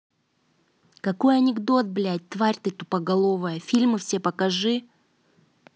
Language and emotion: Russian, angry